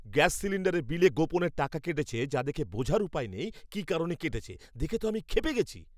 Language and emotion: Bengali, angry